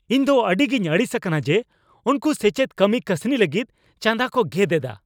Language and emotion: Santali, angry